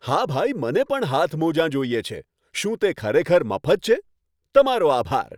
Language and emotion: Gujarati, happy